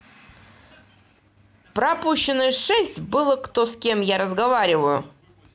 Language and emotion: Russian, angry